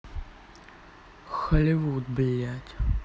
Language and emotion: Russian, angry